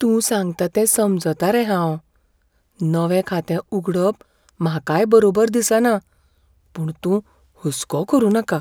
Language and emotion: Goan Konkani, fearful